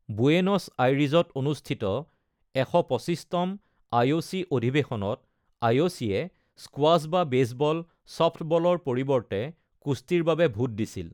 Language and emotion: Assamese, neutral